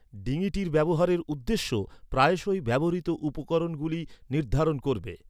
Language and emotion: Bengali, neutral